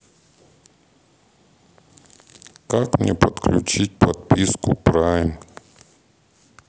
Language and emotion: Russian, neutral